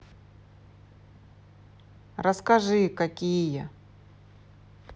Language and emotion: Russian, neutral